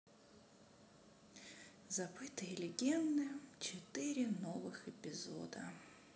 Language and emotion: Russian, sad